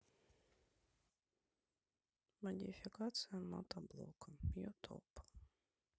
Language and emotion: Russian, neutral